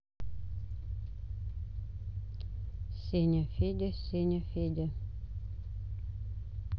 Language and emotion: Russian, neutral